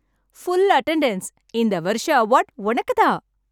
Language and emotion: Tamil, happy